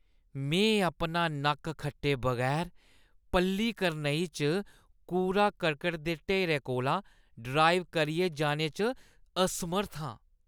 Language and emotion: Dogri, disgusted